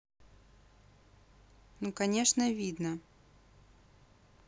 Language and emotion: Russian, neutral